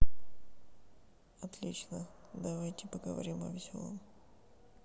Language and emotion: Russian, sad